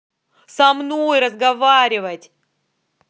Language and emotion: Russian, angry